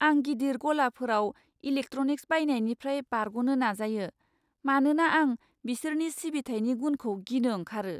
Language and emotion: Bodo, fearful